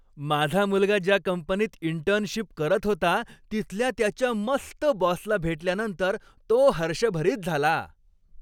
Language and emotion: Marathi, happy